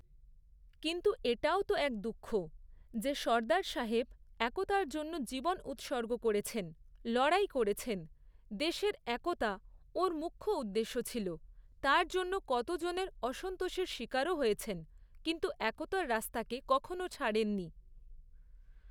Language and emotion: Bengali, neutral